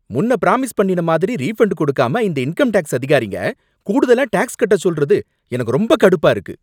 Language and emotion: Tamil, angry